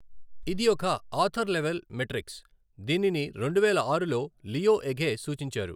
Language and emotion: Telugu, neutral